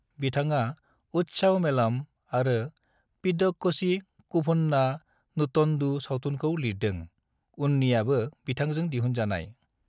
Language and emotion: Bodo, neutral